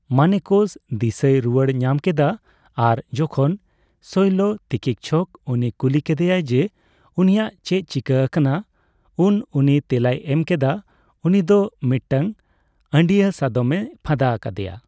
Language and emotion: Santali, neutral